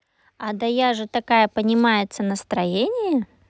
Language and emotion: Russian, positive